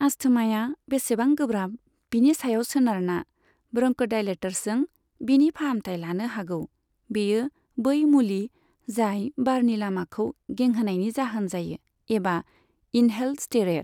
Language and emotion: Bodo, neutral